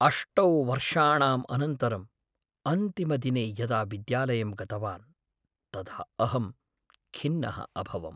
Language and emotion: Sanskrit, sad